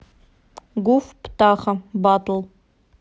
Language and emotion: Russian, neutral